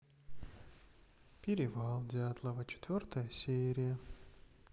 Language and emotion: Russian, sad